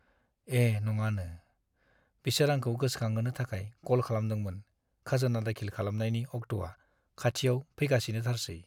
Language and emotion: Bodo, sad